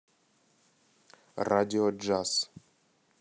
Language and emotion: Russian, neutral